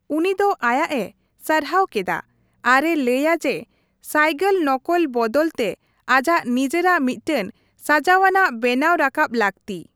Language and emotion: Santali, neutral